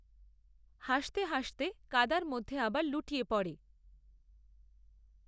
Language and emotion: Bengali, neutral